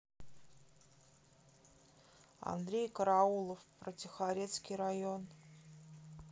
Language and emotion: Russian, neutral